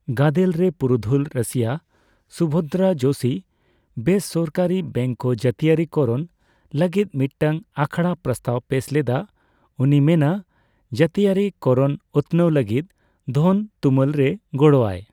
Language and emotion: Santali, neutral